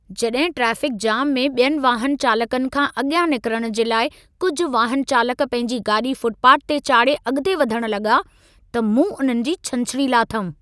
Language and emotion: Sindhi, angry